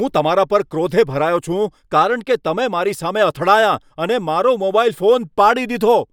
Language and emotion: Gujarati, angry